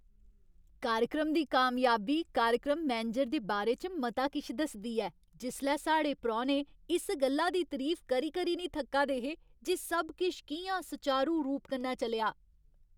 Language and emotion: Dogri, happy